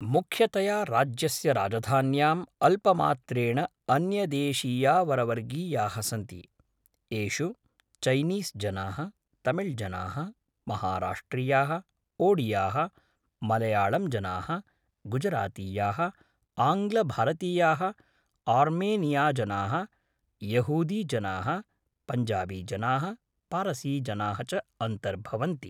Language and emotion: Sanskrit, neutral